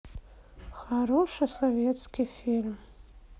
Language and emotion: Russian, sad